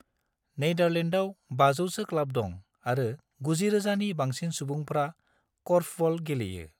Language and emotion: Bodo, neutral